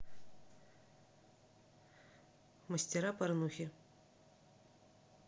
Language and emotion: Russian, neutral